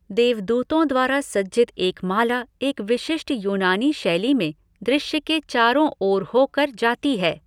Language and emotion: Hindi, neutral